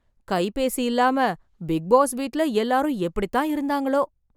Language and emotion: Tamil, surprised